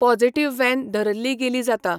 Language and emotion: Goan Konkani, neutral